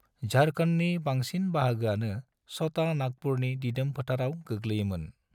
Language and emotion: Bodo, neutral